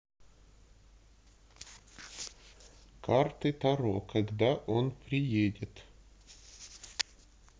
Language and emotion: Russian, neutral